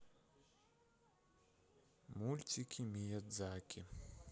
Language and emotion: Russian, neutral